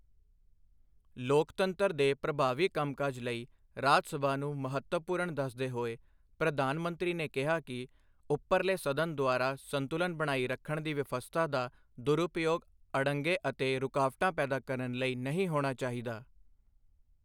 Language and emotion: Punjabi, neutral